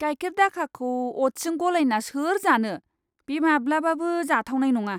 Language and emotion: Bodo, disgusted